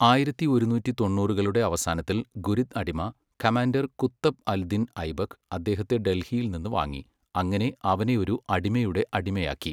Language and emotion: Malayalam, neutral